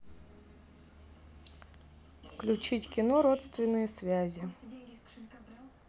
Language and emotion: Russian, neutral